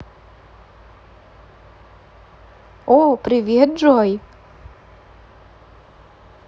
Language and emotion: Russian, positive